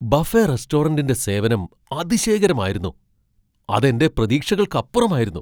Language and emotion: Malayalam, surprised